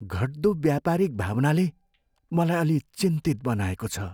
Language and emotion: Nepali, fearful